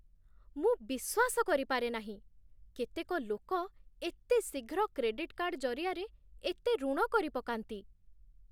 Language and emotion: Odia, surprised